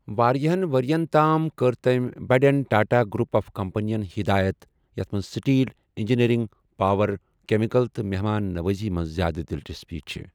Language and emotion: Kashmiri, neutral